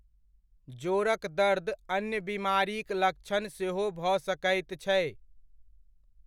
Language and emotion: Maithili, neutral